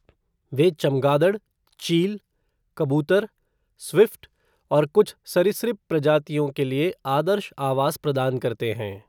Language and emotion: Hindi, neutral